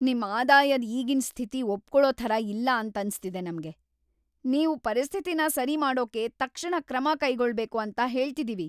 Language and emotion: Kannada, angry